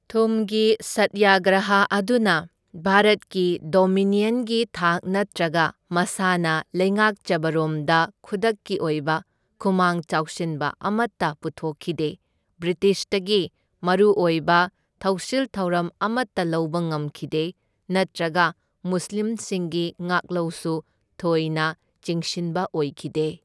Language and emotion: Manipuri, neutral